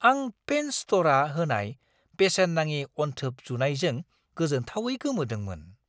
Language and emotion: Bodo, surprised